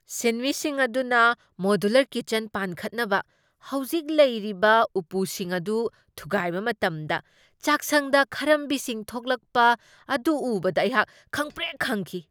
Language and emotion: Manipuri, surprised